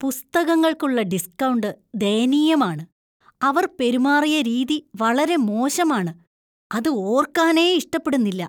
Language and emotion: Malayalam, disgusted